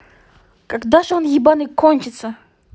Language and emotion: Russian, angry